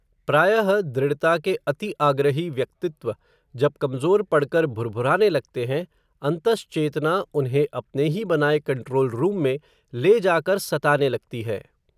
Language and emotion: Hindi, neutral